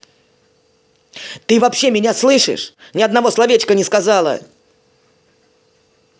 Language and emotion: Russian, angry